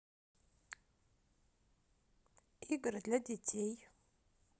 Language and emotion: Russian, neutral